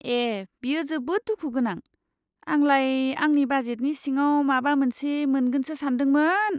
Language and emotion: Bodo, disgusted